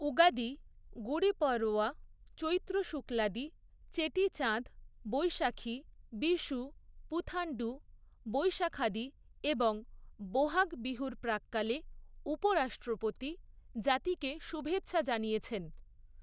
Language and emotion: Bengali, neutral